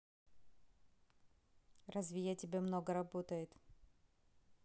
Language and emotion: Russian, neutral